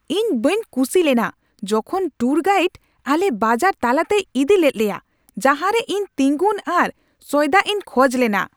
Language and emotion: Santali, angry